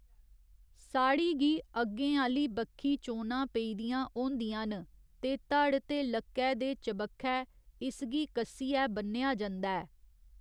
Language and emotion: Dogri, neutral